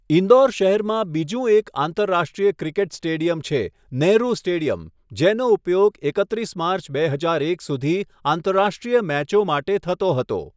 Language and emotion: Gujarati, neutral